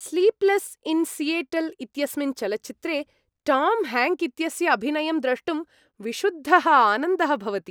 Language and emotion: Sanskrit, happy